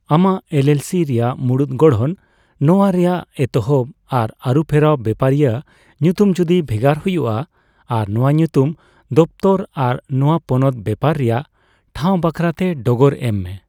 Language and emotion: Santali, neutral